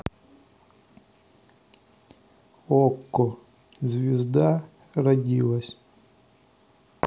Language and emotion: Russian, neutral